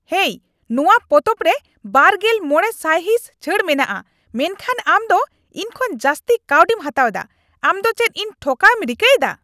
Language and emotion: Santali, angry